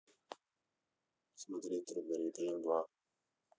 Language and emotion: Russian, neutral